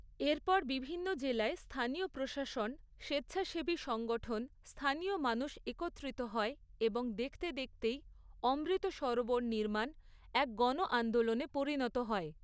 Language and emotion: Bengali, neutral